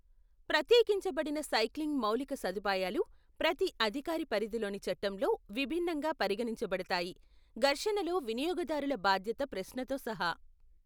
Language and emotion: Telugu, neutral